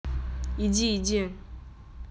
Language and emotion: Russian, angry